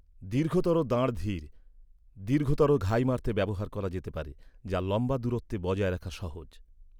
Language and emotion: Bengali, neutral